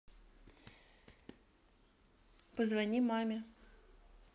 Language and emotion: Russian, neutral